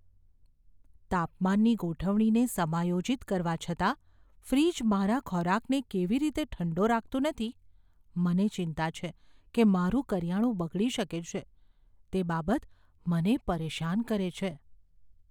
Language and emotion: Gujarati, fearful